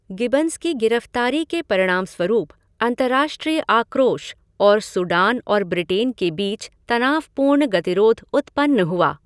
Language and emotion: Hindi, neutral